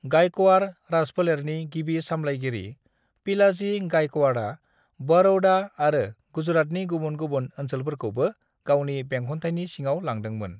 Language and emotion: Bodo, neutral